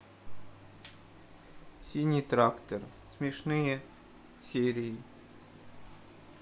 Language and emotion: Russian, sad